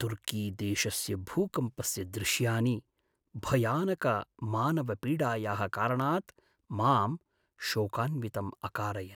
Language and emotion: Sanskrit, sad